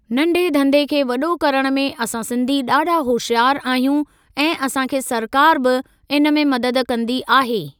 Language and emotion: Sindhi, neutral